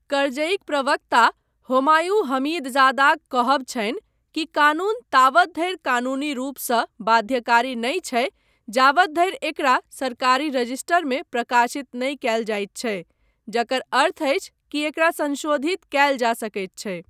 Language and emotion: Maithili, neutral